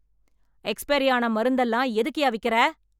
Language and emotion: Tamil, angry